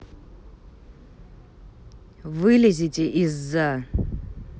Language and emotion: Russian, neutral